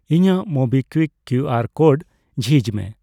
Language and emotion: Santali, neutral